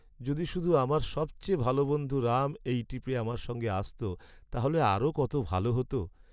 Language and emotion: Bengali, sad